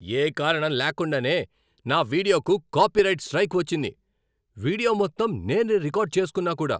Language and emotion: Telugu, angry